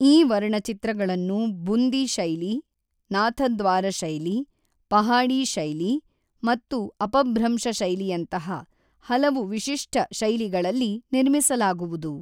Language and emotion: Kannada, neutral